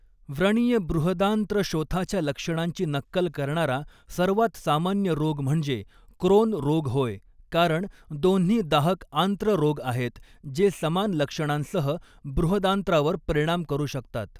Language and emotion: Marathi, neutral